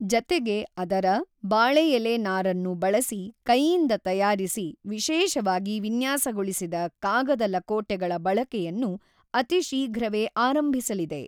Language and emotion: Kannada, neutral